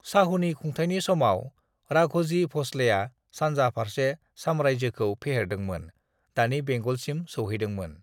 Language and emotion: Bodo, neutral